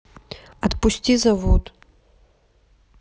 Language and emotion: Russian, neutral